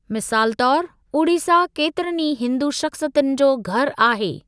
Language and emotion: Sindhi, neutral